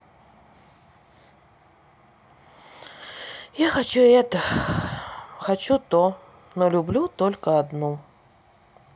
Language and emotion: Russian, sad